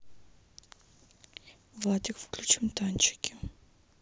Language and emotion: Russian, sad